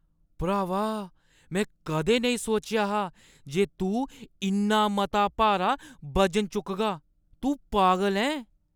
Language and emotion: Dogri, surprised